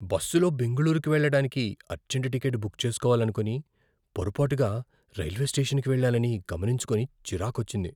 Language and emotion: Telugu, fearful